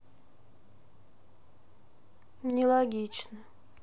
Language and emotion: Russian, sad